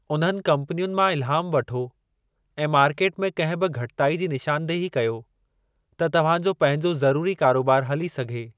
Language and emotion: Sindhi, neutral